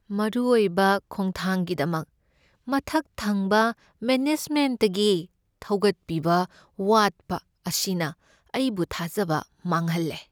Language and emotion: Manipuri, sad